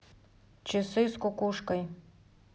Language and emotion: Russian, neutral